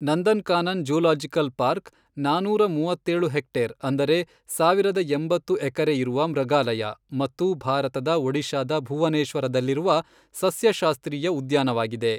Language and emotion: Kannada, neutral